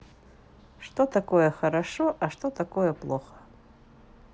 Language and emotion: Russian, neutral